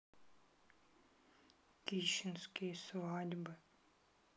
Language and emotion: Russian, sad